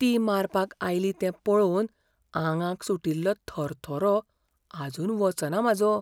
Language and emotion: Goan Konkani, fearful